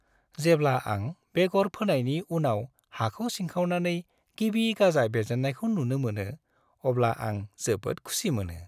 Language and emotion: Bodo, happy